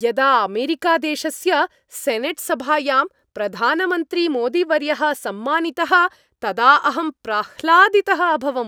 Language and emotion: Sanskrit, happy